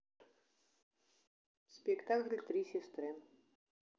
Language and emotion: Russian, neutral